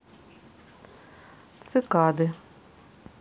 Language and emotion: Russian, neutral